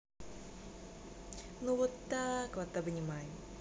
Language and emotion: Russian, positive